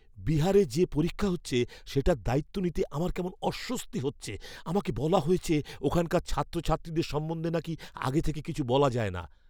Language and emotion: Bengali, fearful